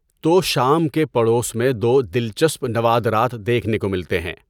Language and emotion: Urdu, neutral